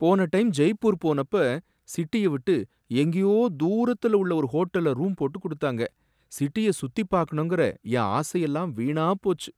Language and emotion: Tamil, sad